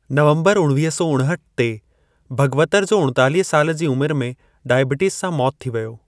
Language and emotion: Sindhi, neutral